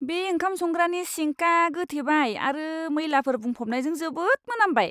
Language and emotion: Bodo, disgusted